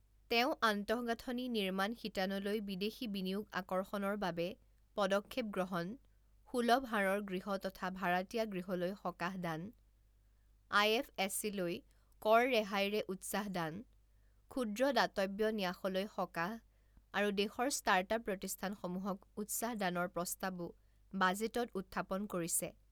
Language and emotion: Assamese, neutral